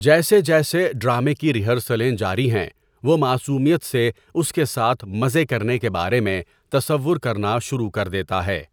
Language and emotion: Urdu, neutral